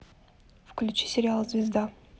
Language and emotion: Russian, neutral